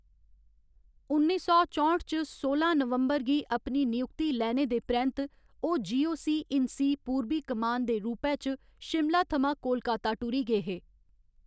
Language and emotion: Dogri, neutral